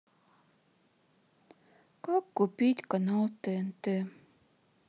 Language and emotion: Russian, sad